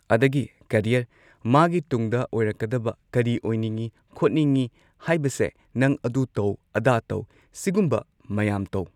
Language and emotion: Manipuri, neutral